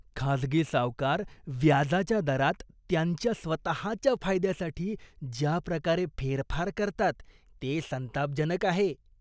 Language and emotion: Marathi, disgusted